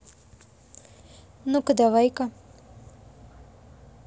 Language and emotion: Russian, neutral